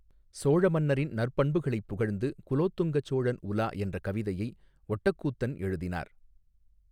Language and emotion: Tamil, neutral